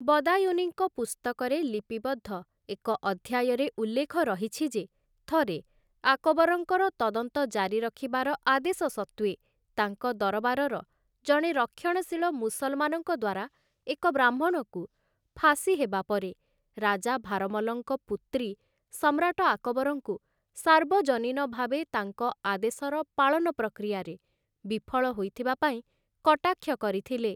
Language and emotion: Odia, neutral